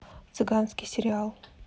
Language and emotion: Russian, neutral